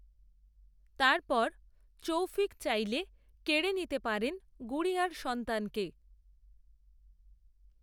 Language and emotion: Bengali, neutral